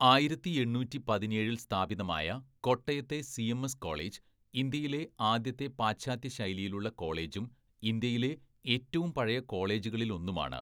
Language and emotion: Malayalam, neutral